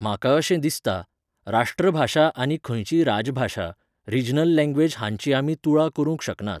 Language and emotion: Goan Konkani, neutral